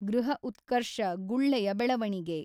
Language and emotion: Kannada, neutral